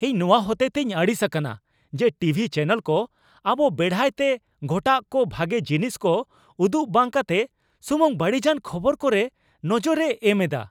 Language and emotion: Santali, angry